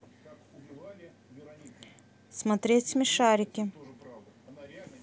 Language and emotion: Russian, neutral